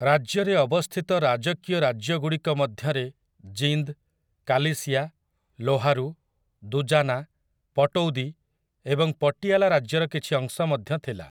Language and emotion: Odia, neutral